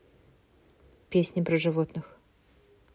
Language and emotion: Russian, neutral